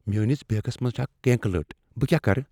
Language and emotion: Kashmiri, fearful